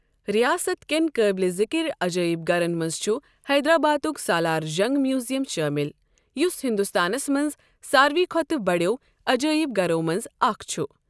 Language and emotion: Kashmiri, neutral